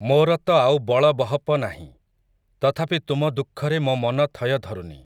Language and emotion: Odia, neutral